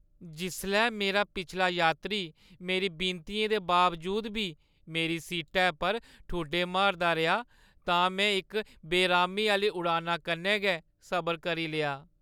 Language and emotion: Dogri, sad